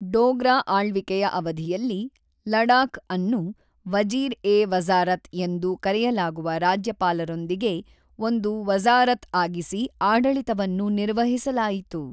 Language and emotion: Kannada, neutral